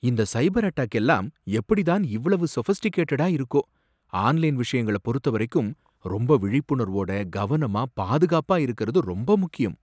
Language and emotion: Tamil, surprised